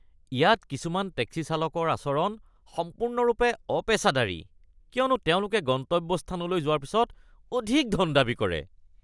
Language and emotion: Assamese, disgusted